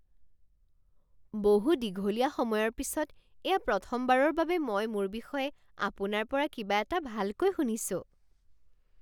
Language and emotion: Assamese, surprised